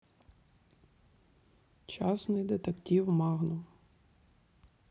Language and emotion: Russian, neutral